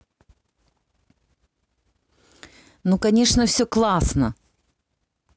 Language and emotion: Russian, positive